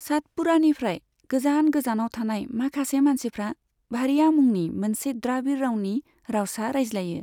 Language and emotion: Bodo, neutral